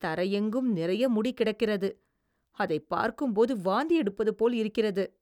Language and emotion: Tamil, disgusted